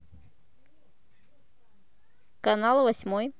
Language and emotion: Russian, neutral